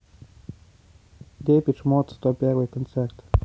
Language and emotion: Russian, neutral